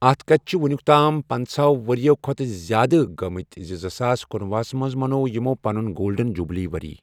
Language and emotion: Kashmiri, neutral